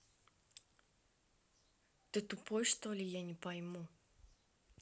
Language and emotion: Russian, angry